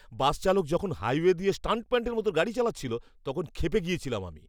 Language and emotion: Bengali, angry